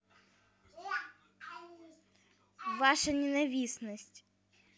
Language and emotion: Russian, neutral